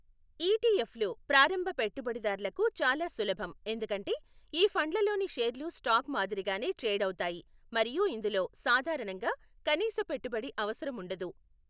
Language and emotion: Telugu, neutral